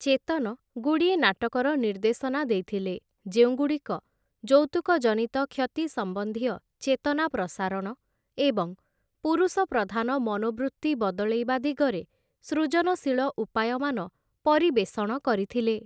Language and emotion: Odia, neutral